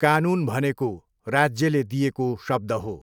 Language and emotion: Nepali, neutral